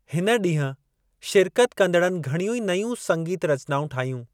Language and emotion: Sindhi, neutral